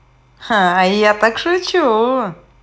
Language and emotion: Russian, positive